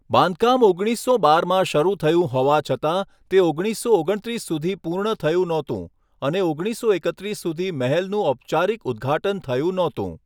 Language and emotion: Gujarati, neutral